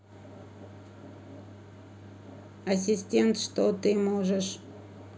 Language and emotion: Russian, neutral